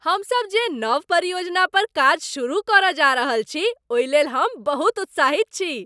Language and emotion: Maithili, happy